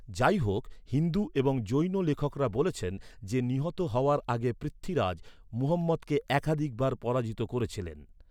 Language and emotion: Bengali, neutral